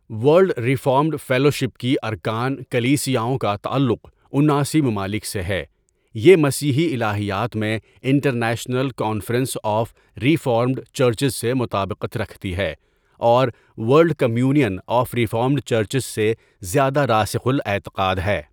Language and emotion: Urdu, neutral